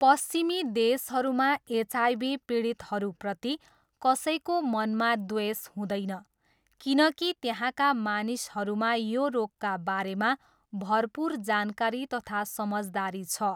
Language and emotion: Nepali, neutral